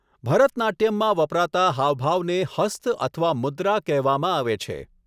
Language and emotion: Gujarati, neutral